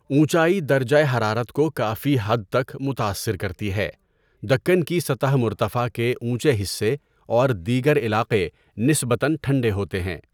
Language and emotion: Urdu, neutral